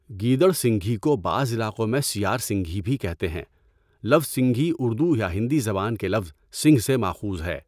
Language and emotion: Urdu, neutral